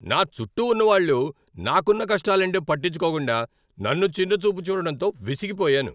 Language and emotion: Telugu, angry